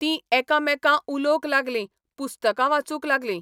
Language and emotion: Goan Konkani, neutral